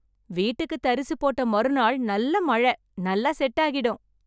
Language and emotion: Tamil, happy